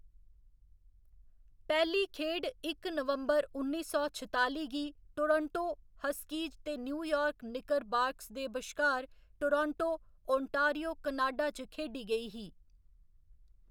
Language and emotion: Dogri, neutral